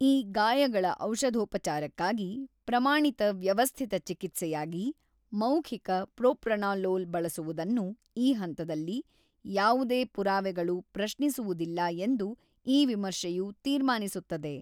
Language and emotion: Kannada, neutral